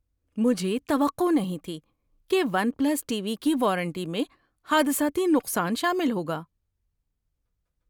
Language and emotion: Urdu, surprised